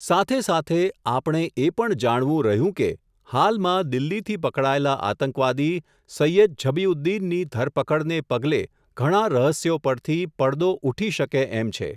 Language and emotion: Gujarati, neutral